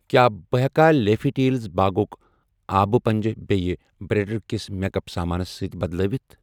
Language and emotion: Kashmiri, neutral